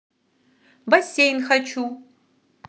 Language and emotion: Russian, positive